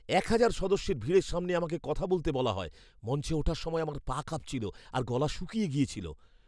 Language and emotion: Bengali, fearful